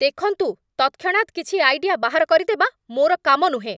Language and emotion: Odia, angry